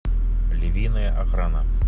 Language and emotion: Russian, neutral